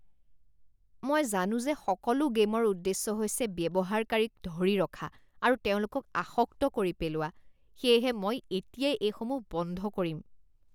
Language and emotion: Assamese, disgusted